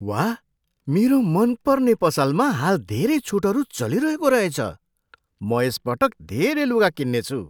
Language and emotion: Nepali, surprised